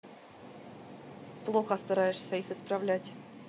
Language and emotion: Russian, neutral